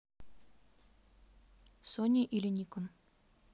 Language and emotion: Russian, neutral